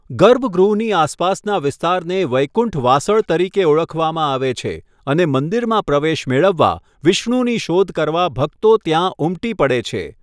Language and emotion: Gujarati, neutral